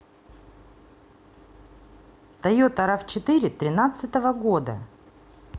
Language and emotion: Russian, neutral